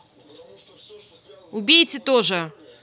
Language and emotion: Russian, angry